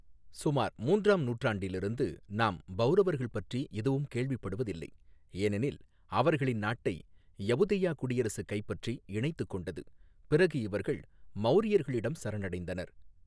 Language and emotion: Tamil, neutral